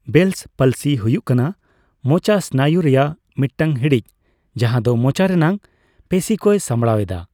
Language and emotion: Santali, neutral